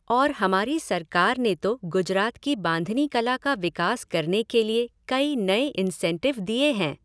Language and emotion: Hindi, neutral